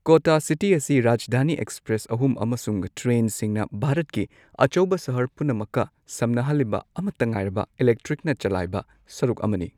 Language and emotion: Manipuri, neutral